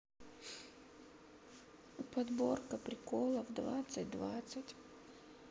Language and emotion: Russian, sad